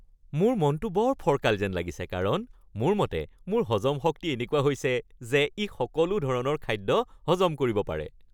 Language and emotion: Assamese, happy